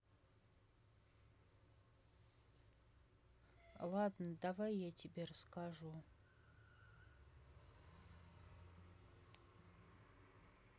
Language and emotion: Russian, sad